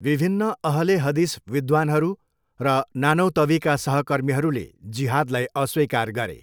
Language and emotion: Nepali, neutral